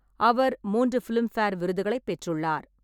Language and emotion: Tamil, neutral